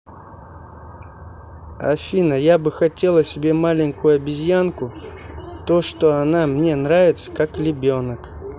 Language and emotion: Russian, neutral